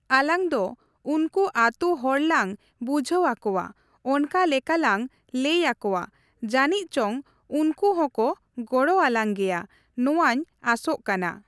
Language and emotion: Santali, neutral